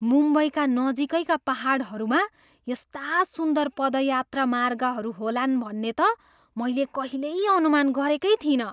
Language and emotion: Nepali, surprised